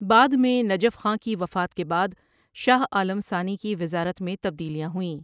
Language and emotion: Urdu, neutral